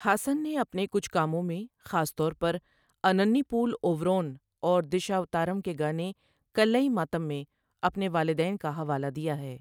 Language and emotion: Urdu, neutral